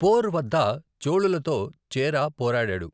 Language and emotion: Telugu, neutral